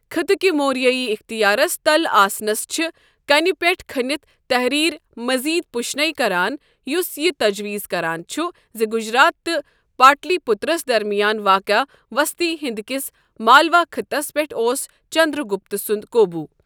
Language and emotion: Kashmiri, neutral